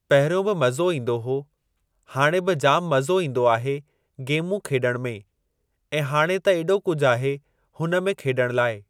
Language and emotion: Sindhi, neutral